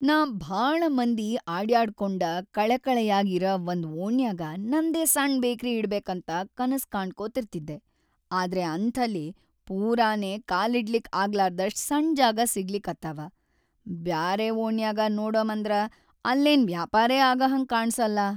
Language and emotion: Kannada, sad